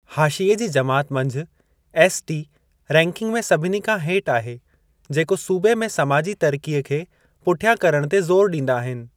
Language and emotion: Sindhi, neutral